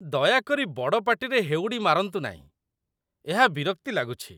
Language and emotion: Odia, disgusted